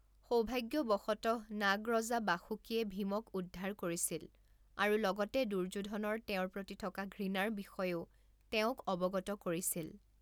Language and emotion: Assamese, neutral